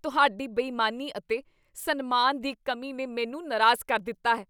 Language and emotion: Punjabi, disgusted